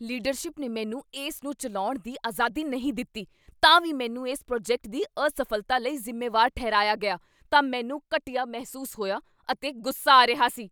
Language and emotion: Punjabi, angry